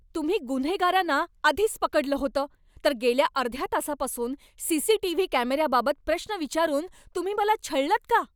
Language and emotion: Marathi, angry